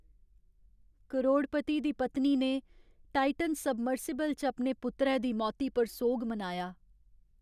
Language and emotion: Dogri, sad